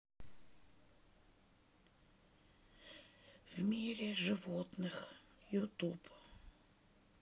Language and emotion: Russian, sad